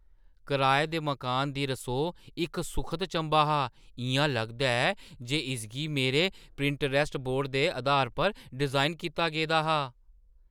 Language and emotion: Dogri, surprised